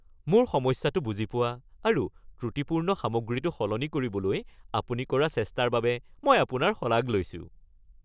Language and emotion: Assamese, happy